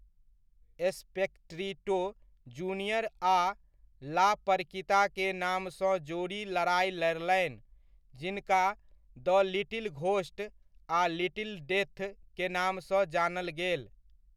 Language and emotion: Maithili, neutral